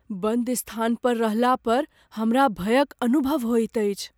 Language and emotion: Maithili, fearful